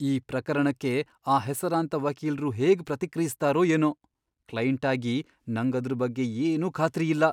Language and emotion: Kannada, fearful